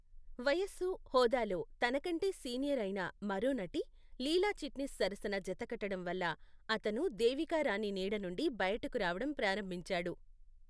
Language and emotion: Telugu, neutral